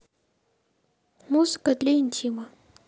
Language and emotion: Russian, neutral